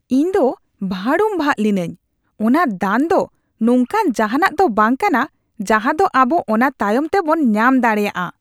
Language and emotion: Santali, disgusted